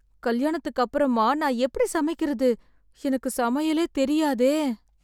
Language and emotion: Tamil, sad